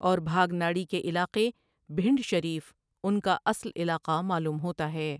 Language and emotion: Urdu, neutral